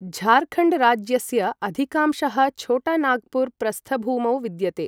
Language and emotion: Sanskrit, neutral